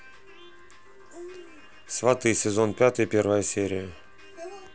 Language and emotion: Russian, neutral